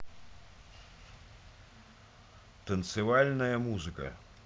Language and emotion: Russian, neutral